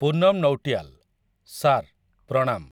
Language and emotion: Odia, neutral